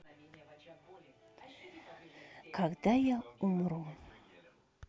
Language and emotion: Russian, sad